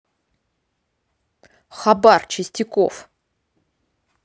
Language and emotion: Russian, neutral